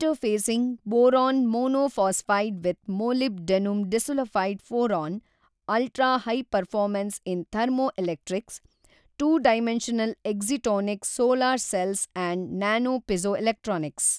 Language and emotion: Kannada, neutral